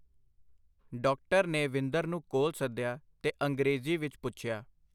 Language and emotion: Punjabi, neutral